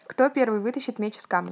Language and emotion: Russian, neutral